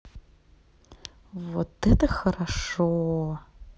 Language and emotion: Russian, positive